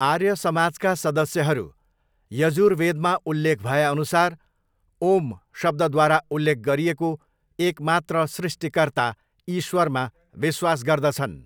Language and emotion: Nepali, neutral